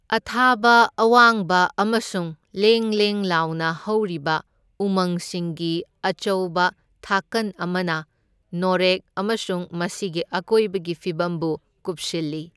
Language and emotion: Manipuri, neutral